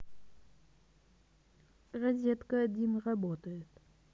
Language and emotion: Russian, neutral